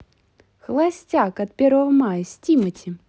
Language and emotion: Russian, positive